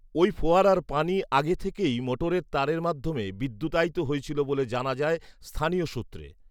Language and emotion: Bengali, neutral